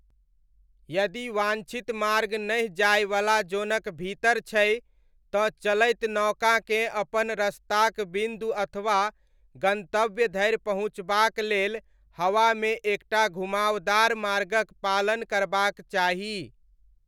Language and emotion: Maithili, neutral